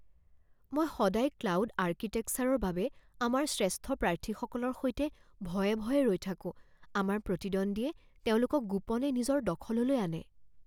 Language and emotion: Assamese, fearful